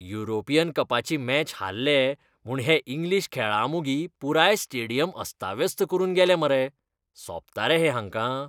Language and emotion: Goan Konkani, disgusted